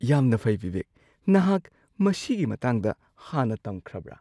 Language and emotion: Manipuri, surprised